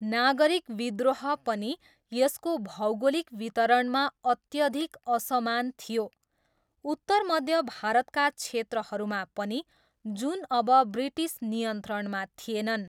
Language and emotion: Nepali, neutral